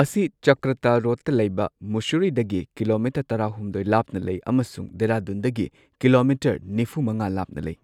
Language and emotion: Manipuri, neutral